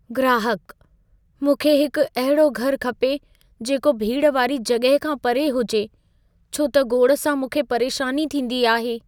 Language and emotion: Sindhi, fearful